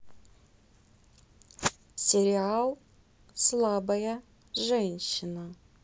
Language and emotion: Russian, neutral